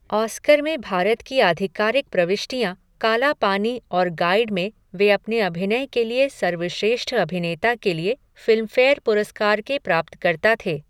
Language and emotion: Hindi, neutral